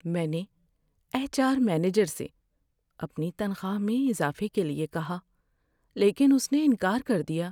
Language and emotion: Urdu, sad